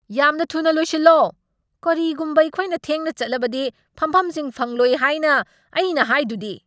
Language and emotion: Manipuri, angry